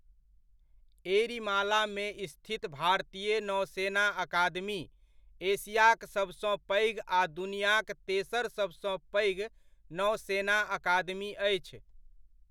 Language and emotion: Maithili, neutral